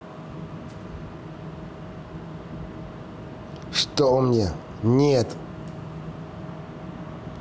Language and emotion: Russian, angry